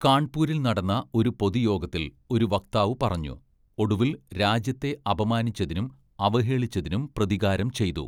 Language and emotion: Malayalam, neutral